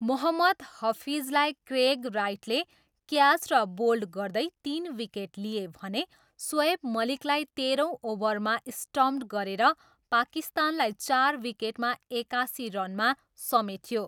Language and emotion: Nepali, neutral